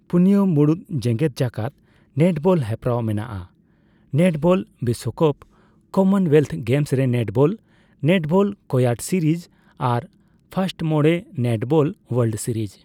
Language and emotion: Santali, neutral